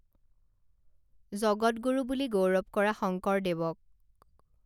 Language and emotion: Assamese, neutral